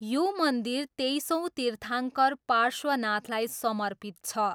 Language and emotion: Nepali, neutral